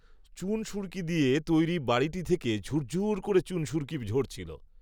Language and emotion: Bengali, neutral